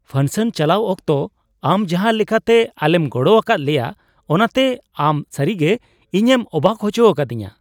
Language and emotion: Santali, surprised